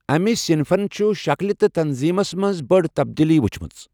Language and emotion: Kashmiri, neutral